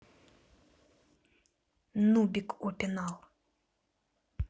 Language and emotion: Russian, neutral